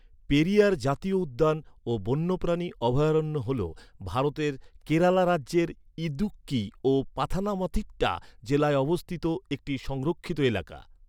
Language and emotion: Bengali, neutral